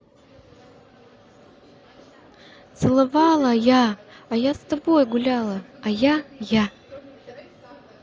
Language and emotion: Russian, neutral